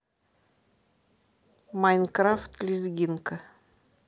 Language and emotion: Russian, neutral